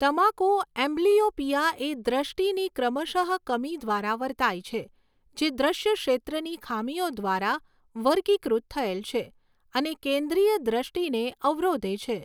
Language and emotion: Gujarati, neutral